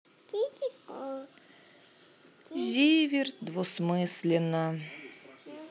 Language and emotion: Russian, sad